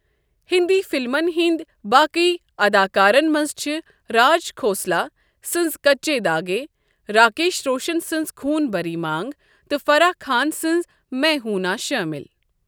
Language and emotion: Kashmiri, neutral